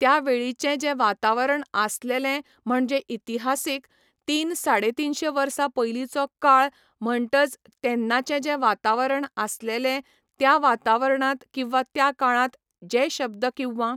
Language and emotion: Goan Konkani, neutral